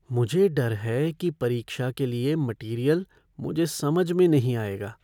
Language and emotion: Hindi, fearful